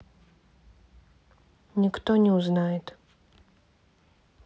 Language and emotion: Russian, neutral